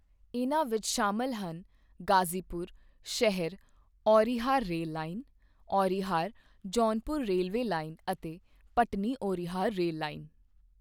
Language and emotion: Punjabi, neutral